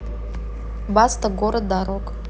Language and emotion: Russian, neutral